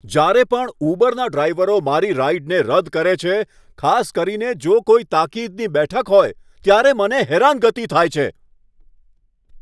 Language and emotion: Gujarati, angry